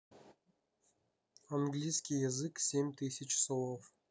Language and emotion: Russian, neutral